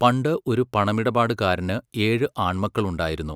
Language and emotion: Malayalam, neutral